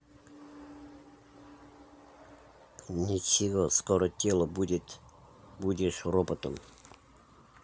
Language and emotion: Russian, neutral